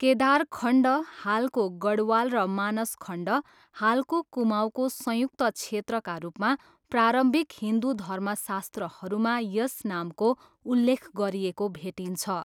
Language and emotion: Nepali, neutral